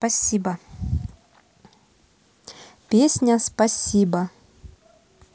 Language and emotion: Russian, neutral